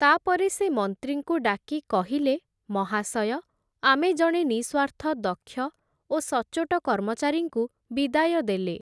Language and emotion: Odia, neutral